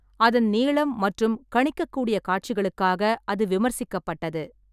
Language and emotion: Tamil, neutral